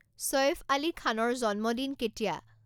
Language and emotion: Assamese, neutral